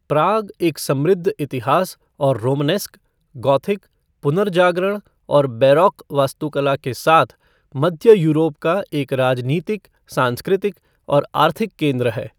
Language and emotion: Hindi, neutral